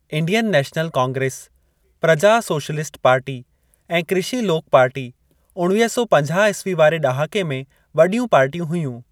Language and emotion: Sindhi, neutral